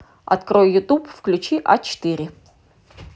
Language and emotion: Russian, neutral